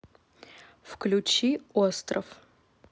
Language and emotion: Russian, neutral